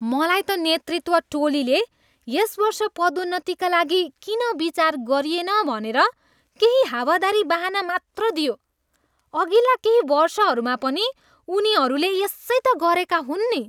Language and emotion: Nepali, disgusted